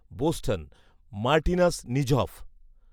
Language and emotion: Bengali, neutral